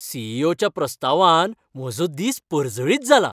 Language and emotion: Goan Konkani, happy